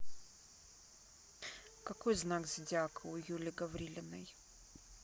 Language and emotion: Russian, neutral